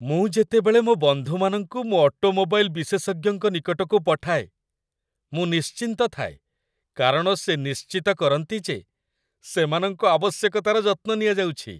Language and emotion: Odia, happy